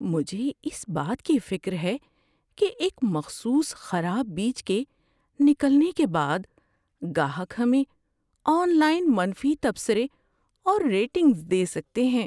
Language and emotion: Urdu, fearful